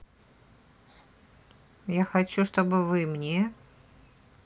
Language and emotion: Russian, neutral